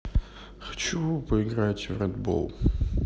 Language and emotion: Russian, sad